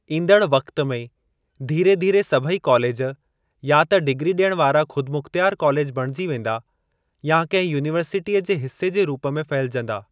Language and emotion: Sindhi, neutral